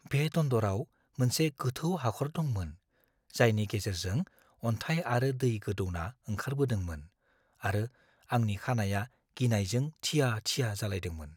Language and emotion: Bodo, fearful